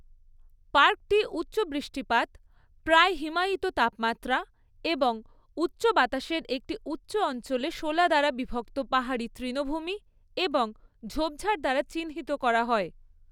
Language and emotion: Bengali, neutral